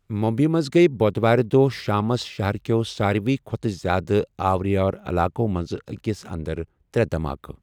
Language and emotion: Kashmiri, neutral